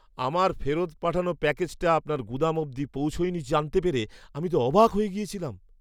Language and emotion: Bengali, surprised